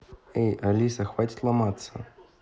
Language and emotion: Russian, neutral